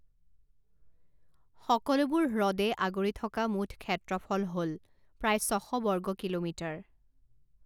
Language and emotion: Assamese, neutral